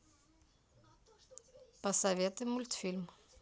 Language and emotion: Russian, neutral